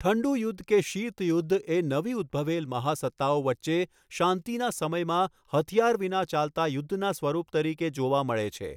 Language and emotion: Gujarati, neutral